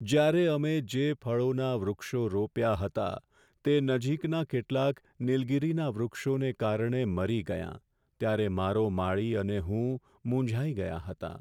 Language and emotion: Gujarati, sad